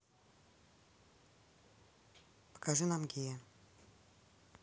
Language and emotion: Russian, neutral